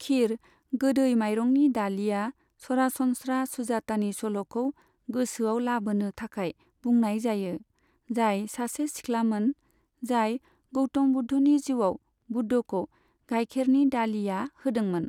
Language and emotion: Bodo, neutral